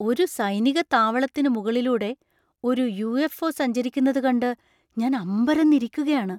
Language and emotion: Malayalam, surprised